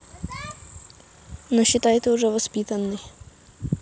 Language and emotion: Russian, neutral